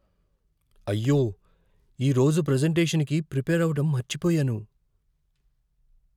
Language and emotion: Telugu, fearful